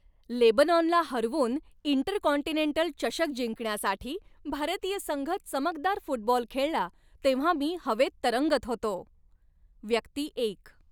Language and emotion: Marathi, happy